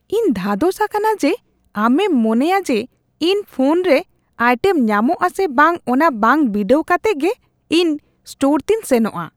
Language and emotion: Santali, disgusted